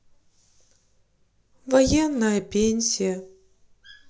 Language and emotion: Russian, sad